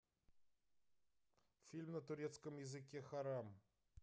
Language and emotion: Russian, neutral